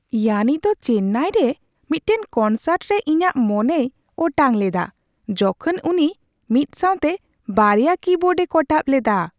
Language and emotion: Santali, surprised